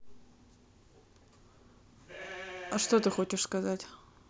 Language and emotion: Russian, neutral